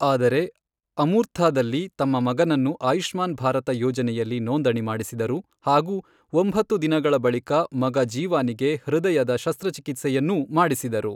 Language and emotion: Kannada, neutral